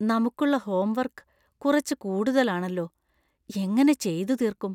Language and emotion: Malayalam, fearful